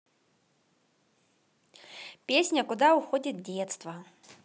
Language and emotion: Russian, positive